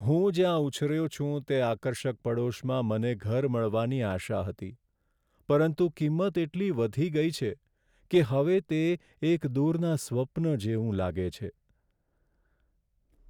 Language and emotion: Gujarati, sad